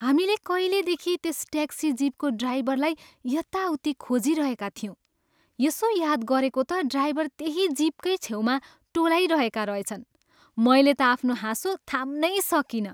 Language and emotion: Nepali, happy